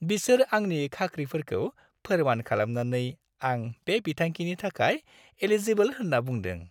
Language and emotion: Bodo, happy